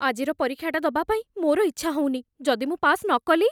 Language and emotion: Odia, fearful